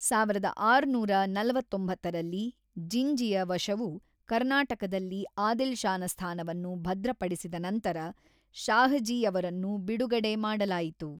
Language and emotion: Kannada, neutral